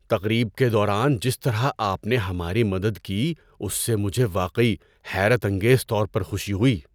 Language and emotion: Urdu, surprised